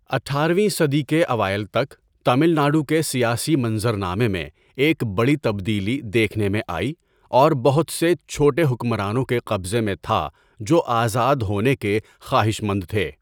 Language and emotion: Urdu, neutral